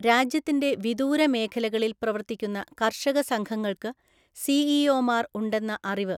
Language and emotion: Malayalam, neutral